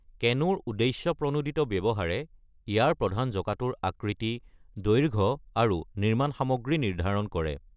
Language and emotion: Assamese, neutral